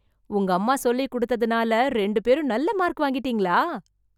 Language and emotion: Tamil, surprised